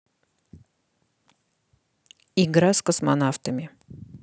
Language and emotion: Russian, neutral